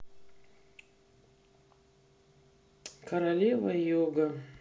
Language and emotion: Russian, sad